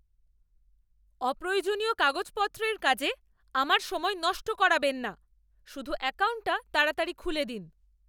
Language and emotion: Bengali, angry